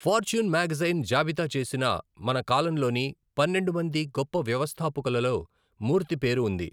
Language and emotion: Telugu, neutral